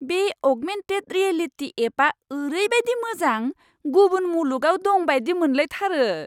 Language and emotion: Bodo, surprised